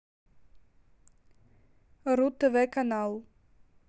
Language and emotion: Russian, neutral